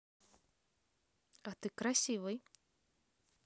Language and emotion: Russian, positive